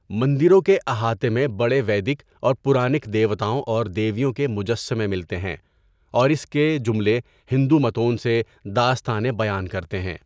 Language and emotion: Urdu, neutral